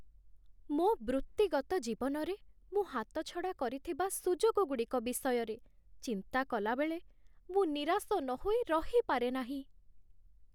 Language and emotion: Odia, sad